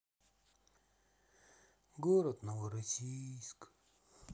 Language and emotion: Russian, sad